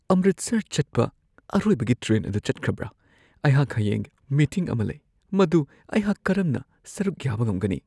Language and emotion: Manipuri, fearful